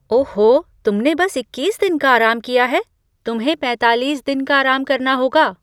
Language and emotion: Hindi, surprised